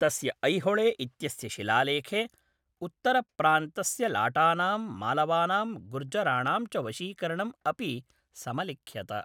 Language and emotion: Sanskrit, neutral